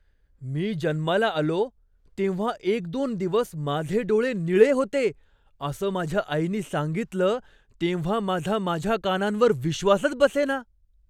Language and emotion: Marathi, surprised